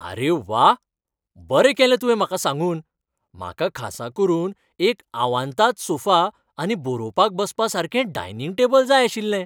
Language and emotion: Goan Konkani, happy